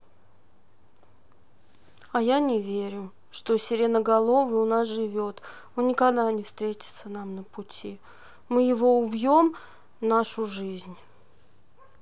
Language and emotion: Russian, sad